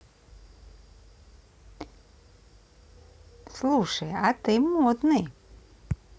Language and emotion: Russian, positive